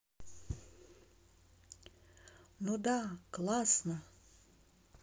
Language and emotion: Russian, positive